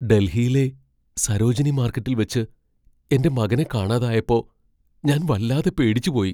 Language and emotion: Malayalam, fearful